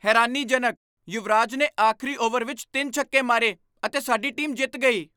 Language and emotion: Punjabi, surprised